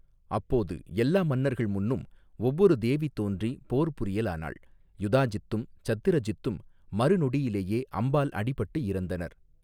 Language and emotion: Tamil, neutral